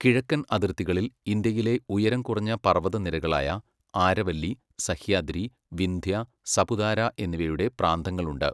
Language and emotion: Malayalam, neutral